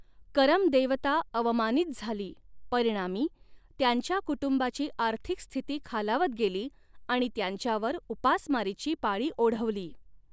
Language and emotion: Marathi, neutral